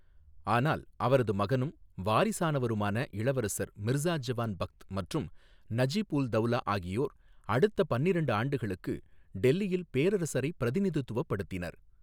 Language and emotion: Tamil, neutral